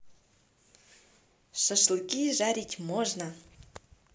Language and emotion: Russian, positive